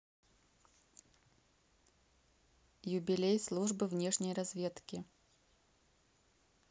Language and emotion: Russian, neutral